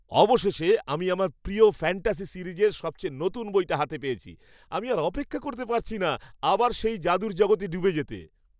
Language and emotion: Bengali, happy